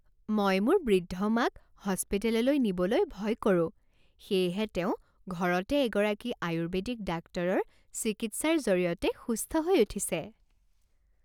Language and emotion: Assamese, happy